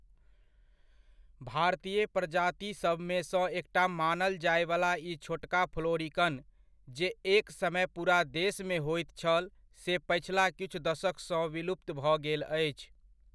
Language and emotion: Maithili, neutral